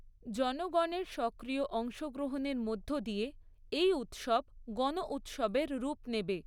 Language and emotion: Bengali, neutral